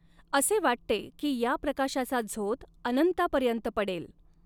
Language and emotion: Marathi, neutral